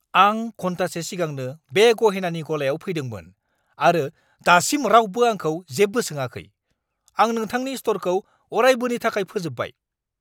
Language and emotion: Bodo, angry